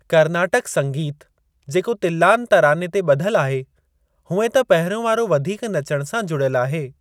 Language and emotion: Sindhi, neutral